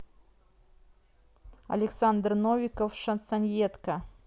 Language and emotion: Russian, neutral